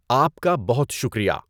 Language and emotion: Urdu, neutral